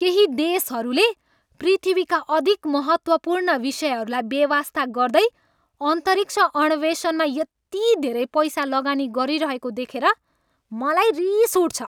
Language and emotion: Nepali, angry